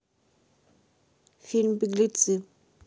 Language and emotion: Russian, neutral